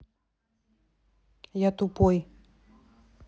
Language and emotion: Russian, neutral